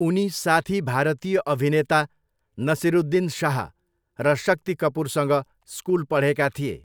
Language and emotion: Nepali, neutral